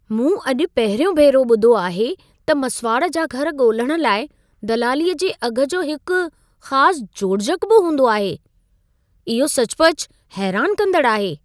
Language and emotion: Sindhi, surprised